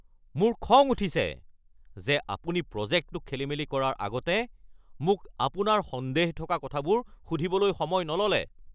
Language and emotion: Assamese, angry